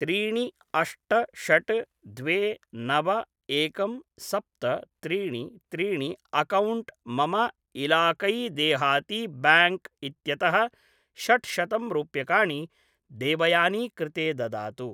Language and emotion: Sanskrit, neutral